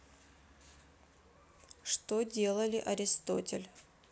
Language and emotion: Russian, neutral